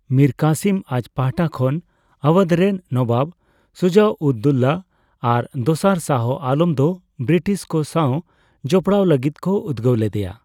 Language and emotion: Santali, neutral